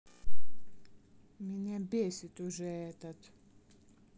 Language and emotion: Russian, angry